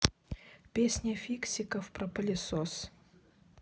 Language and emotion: Russian, neutral